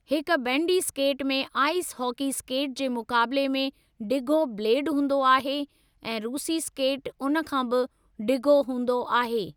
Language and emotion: Sindhi, neutral